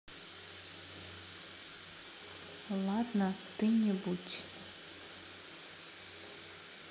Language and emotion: Russian, sad